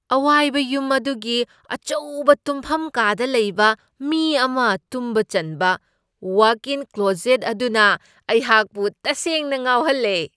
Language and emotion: Manipuri, surprised